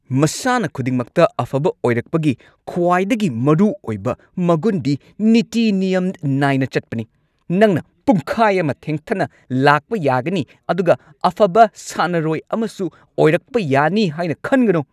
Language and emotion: Manipuri, angry